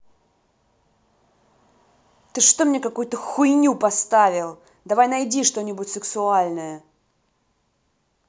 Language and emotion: Russian, angry